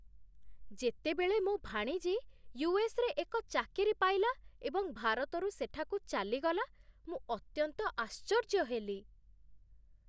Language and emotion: Odia, surprised